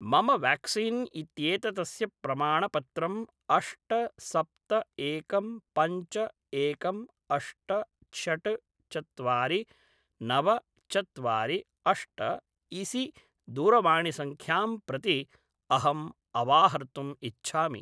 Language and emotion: Sanskrit, neutral